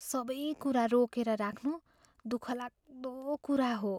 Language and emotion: Nepali, fearful